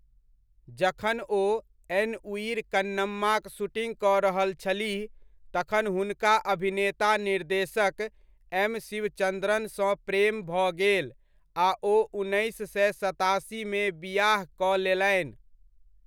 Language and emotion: Maithili, neutral